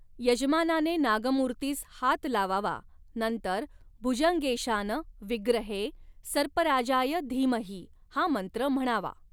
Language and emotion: Marathi, neutral